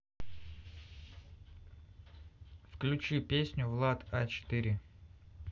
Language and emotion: Russian, neutral